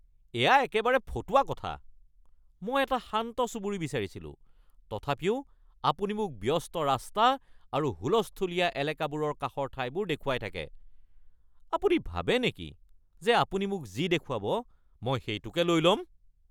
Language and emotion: Assamese, angry